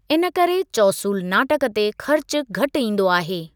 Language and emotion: Sindhi, neutral